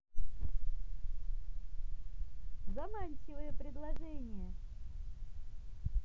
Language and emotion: Russian, positive